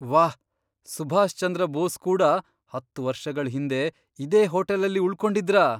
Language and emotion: Kannada, surprised